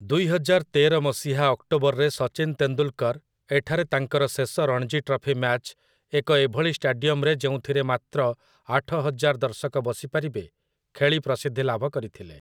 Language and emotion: Odia, neutral